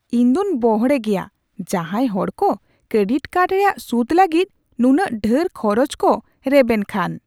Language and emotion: Santali, surprised